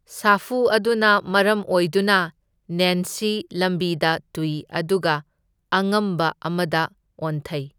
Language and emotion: Manipuri, neutral